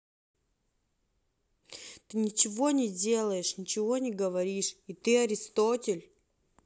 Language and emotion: Russian, neutral